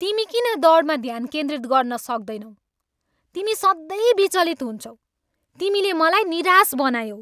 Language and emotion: Nepali, angry